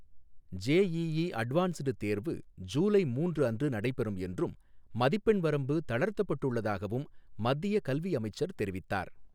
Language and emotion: Tamil, neutral